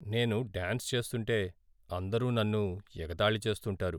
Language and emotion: Telugu, sad